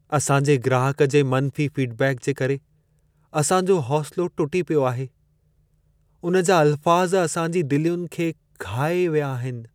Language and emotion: Sindhi, sad